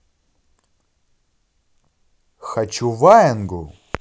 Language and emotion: Russian, positive